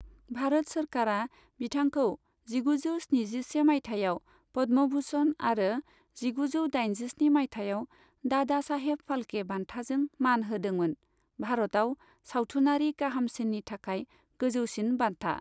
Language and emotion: Bodo, neutral